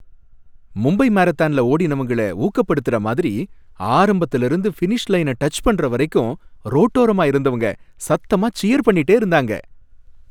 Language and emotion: Tamil, happy